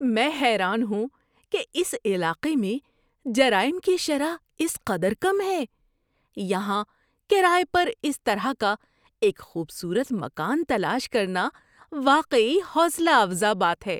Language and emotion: Urdu, surprised